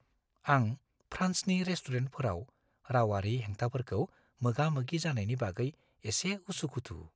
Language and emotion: Bodo, fearful